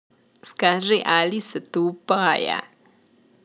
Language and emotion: Russian, positive